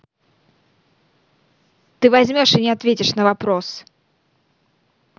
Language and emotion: Russian, angry